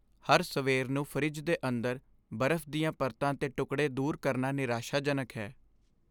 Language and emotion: Punjabi, sad